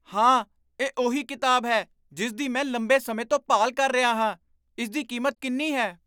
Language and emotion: Punjabi, surprised